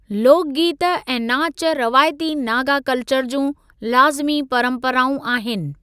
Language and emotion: Sindhi, neutral